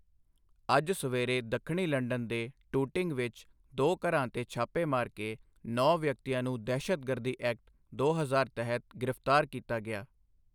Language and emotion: Punjabi, neutral